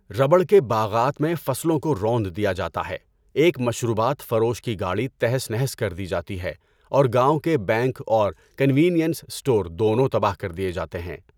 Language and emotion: Urdu, neutral